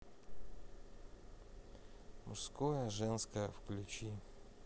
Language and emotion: Russian, sad